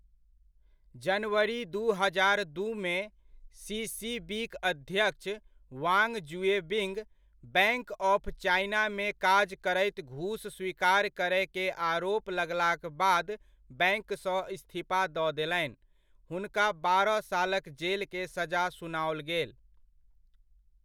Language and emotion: Maithili, neutral